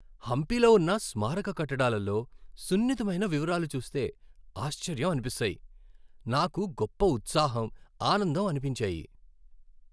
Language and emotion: Telugu, happy